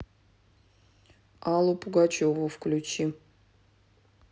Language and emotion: Russian, neutral